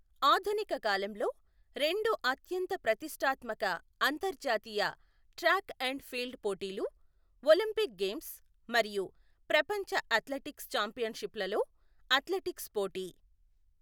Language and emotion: Telugu, neutral